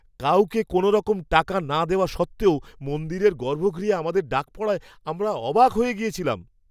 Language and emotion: Bengali, surprised